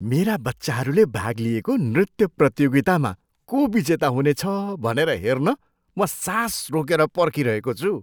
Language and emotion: Nepali, surprised